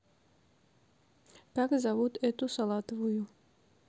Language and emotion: Russian, neutral